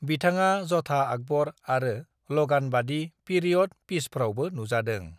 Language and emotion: Bodo, neutral